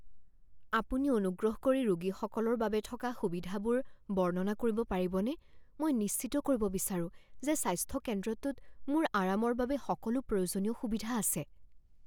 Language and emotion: Assamese, fearful